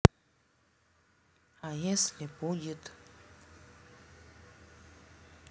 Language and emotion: Russian, neutral